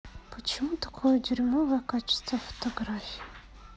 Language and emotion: Russian, sad